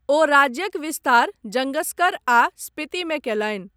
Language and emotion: Maithili, neutral